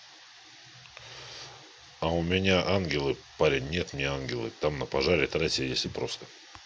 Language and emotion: Russian, neutral